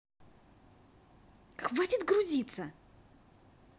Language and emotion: Russian, angry